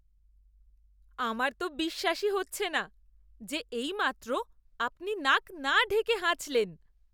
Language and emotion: Bengali, disgusted